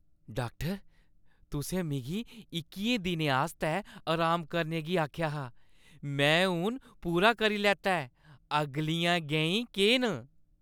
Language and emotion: Dogri, happy